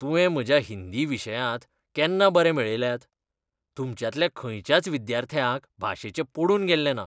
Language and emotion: Goan Konkani, disgusted